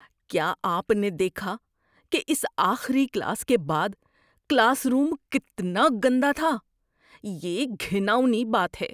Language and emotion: Urdu, disgusted